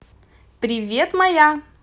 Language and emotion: Russian, positive